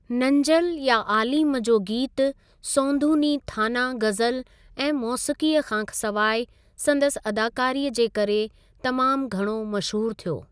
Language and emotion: Sindhi, neutral